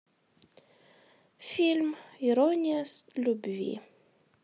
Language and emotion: Russian, sad